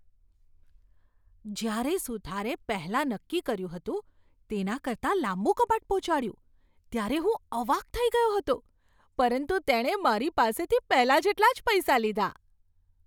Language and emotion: Gujarati, surprised